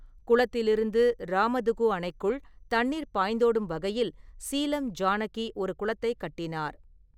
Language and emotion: Tamil, neutral